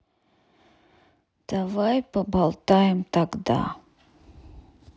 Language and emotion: Russian, sad